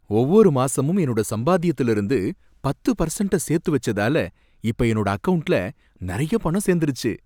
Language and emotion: Tamil, happy